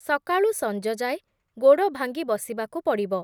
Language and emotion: Odia, neutral